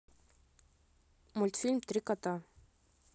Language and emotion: Russian, neutral